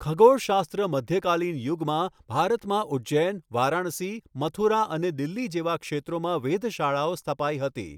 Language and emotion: Gujarati, neutral